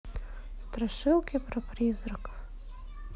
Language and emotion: Russian, neutral